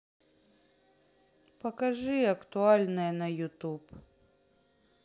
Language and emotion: Russian, sad